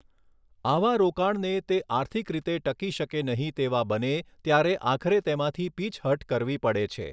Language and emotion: Gujarati, neutral